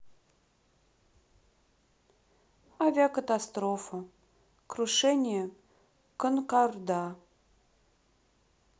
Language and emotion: Russian, sad